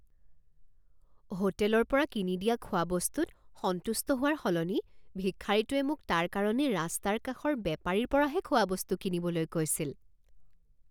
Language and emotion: Assamese, surprised